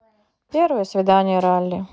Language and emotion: Russian, neutral